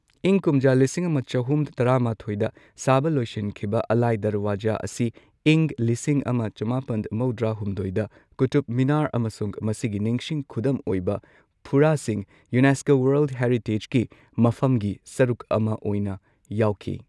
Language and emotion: Manipuri, neutral